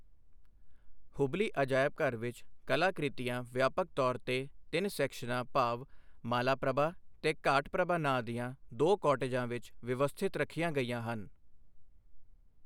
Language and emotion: Punjabi, neutral